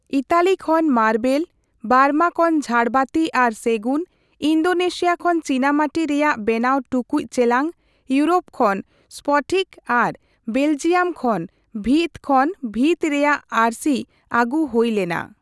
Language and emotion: Santali, neutral